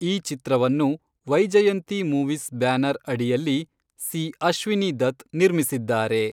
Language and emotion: Kannada, neutral